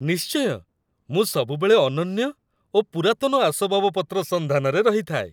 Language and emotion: Odia, happy